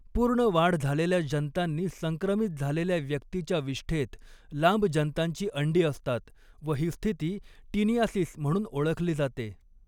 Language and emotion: Marathi, neutral